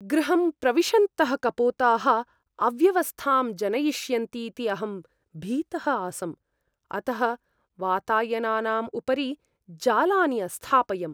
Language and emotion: Sanskrit, fearful